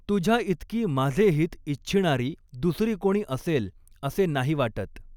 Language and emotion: Marathi, neutral